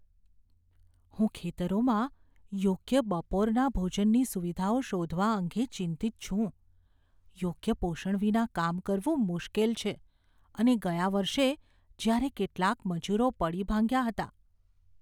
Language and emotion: Gujarati, fearful